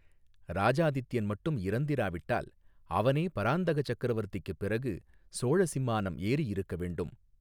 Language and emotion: Tamil, neutral